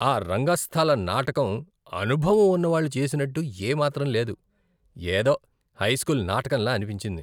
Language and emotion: Telugu, disgusted